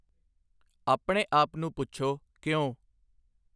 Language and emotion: Punjabi, neutral